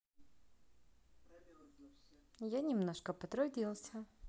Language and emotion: Russian, positive